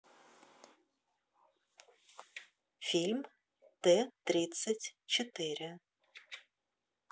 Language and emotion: Russian, neutral